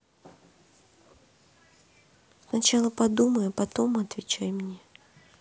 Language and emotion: Russian, sad